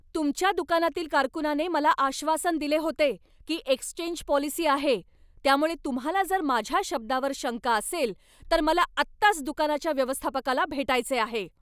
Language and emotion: Marathi, angry